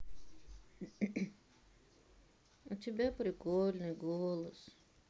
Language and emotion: Russian, sad